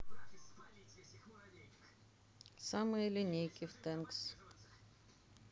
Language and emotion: Russian, neutral